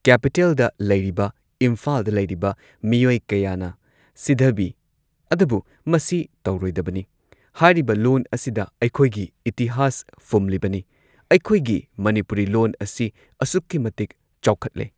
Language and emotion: Manipuri, neutral